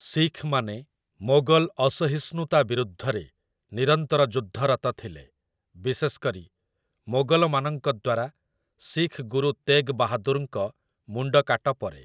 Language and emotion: Odia, neutral